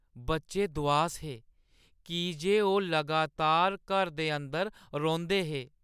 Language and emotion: Dogri, sad